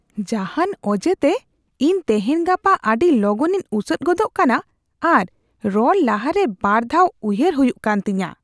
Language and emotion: Santali, disgusted